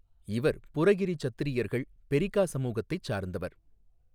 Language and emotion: Tamil, neutral